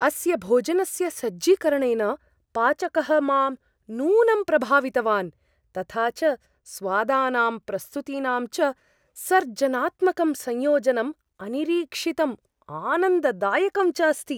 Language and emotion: Sanskrit, surprised